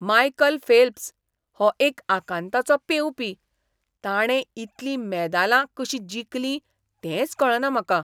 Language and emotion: Goan Konkani, surprised